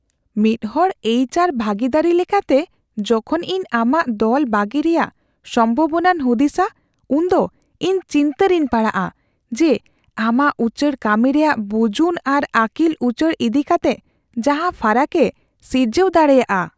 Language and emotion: Santali, fearful